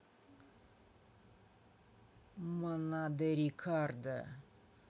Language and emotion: Russian, neutral